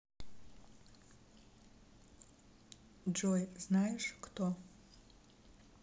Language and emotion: Russian, neutral